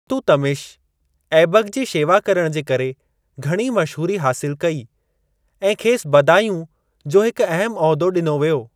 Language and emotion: Sindhi, neutral